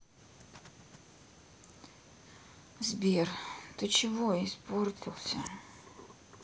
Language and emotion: Russian, sad